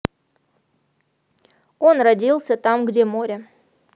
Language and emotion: Russian, neutral